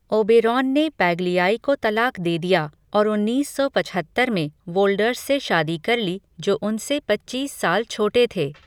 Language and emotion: Hindi, neutral